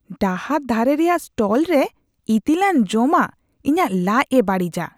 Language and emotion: Santali, disgusted